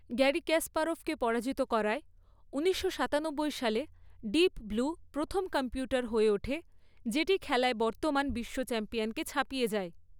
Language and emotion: Bengali, neutral